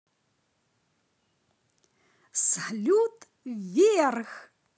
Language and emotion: Russian, positive